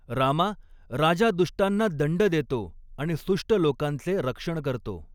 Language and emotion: Marathi, neutral